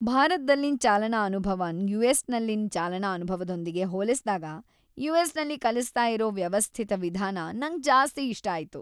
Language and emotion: Kannada, happy